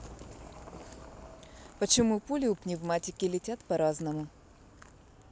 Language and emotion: Russian, neutral